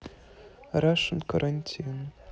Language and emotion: Russian, neutral